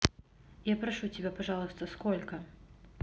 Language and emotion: Russian, neutral